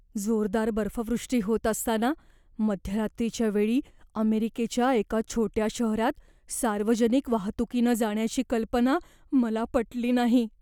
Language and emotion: Marathi, fearful